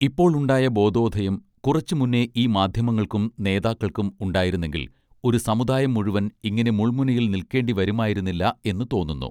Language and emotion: Malayalam, neutral